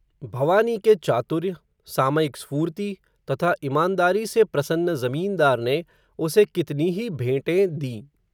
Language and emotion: Hindi, neutral